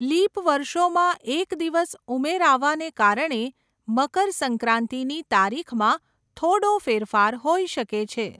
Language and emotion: Gujarati, neutral